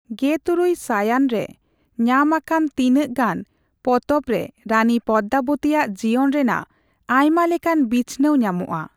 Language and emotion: Santali, neutral